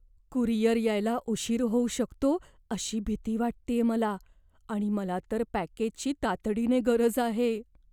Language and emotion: Marathi, fearful